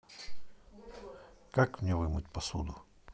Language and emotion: Russian, neutral